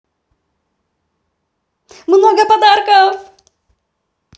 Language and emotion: Russian, positive